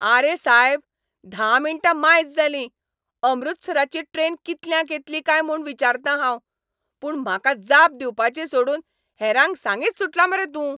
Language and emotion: Goan Konkani, angry